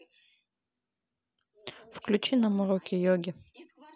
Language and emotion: Russian, neutral